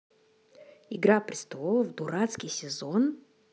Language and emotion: Russian, positive